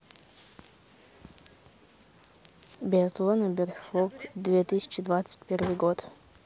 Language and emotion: Russian, neutral